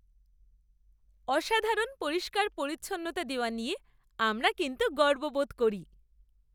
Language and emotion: Bengali, happy